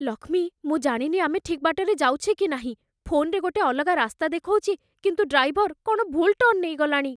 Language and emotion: Odia, fearful